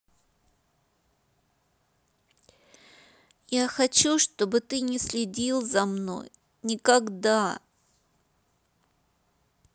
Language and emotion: Russian, sad